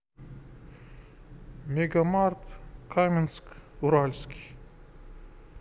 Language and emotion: Russian, neutral